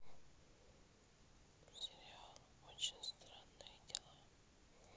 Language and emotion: Russian, neutral